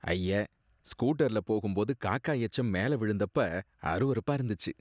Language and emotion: Tamil, disgusted